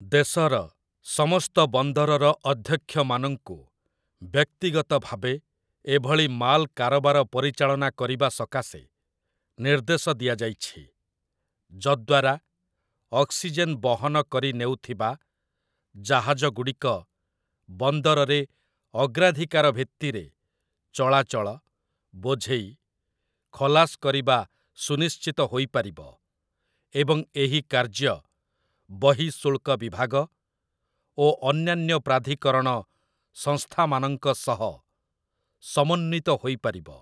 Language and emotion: Odia, neutral